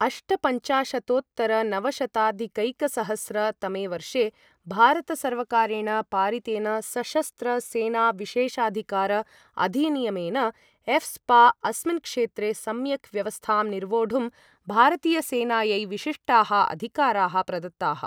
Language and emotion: Sanskrit, neutral